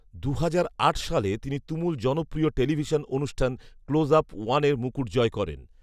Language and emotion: Bengali, neutral